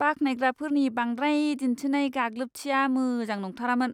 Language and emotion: Bodo, disgusted